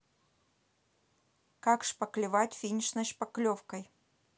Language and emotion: Russian, neutral